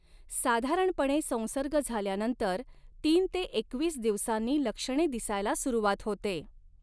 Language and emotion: Marathi, neutral